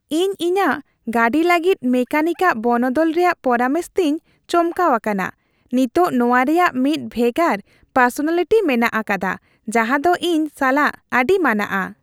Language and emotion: Santali, happy